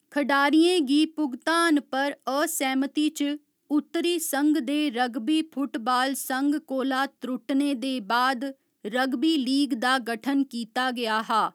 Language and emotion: Dogri, neutral